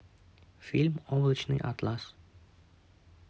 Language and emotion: Russian, neutral